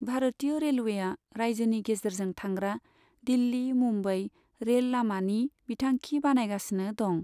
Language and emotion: Bodo, neutral